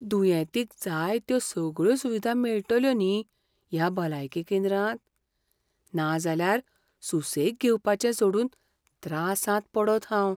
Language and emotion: Goan Konkani, fearful